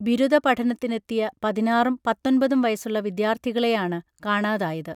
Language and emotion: Malayalam, neutral